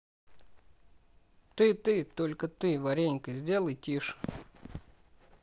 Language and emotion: Russian, neutral